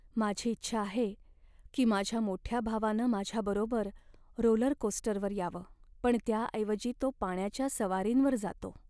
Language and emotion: Marathi, sad